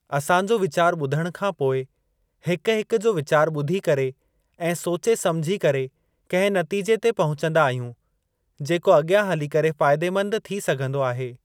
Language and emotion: Sindhi, neutral